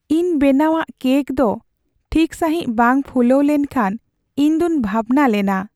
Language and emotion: Santali, sad